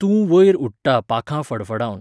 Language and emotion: Goan Konkani, neutral